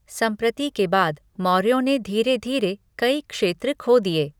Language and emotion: Hindi, neutral